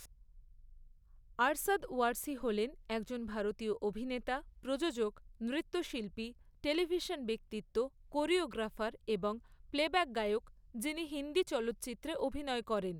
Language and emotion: Bengali, neutral